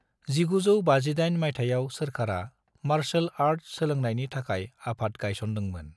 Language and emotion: Bodo, neutral